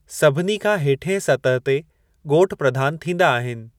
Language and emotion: Sindhi, neutral